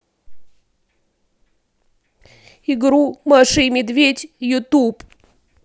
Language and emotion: Russian, sad